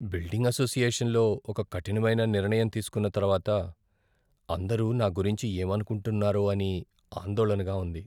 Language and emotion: Telugu, fearful